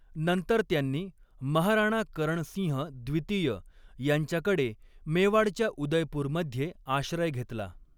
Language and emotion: Marathi, neutral